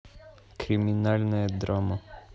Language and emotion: Russian, neutral